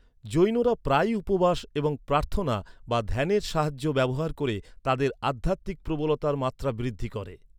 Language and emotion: Bengali, neutral